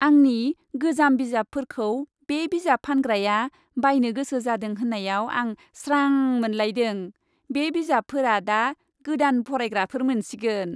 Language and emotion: Bodo, happy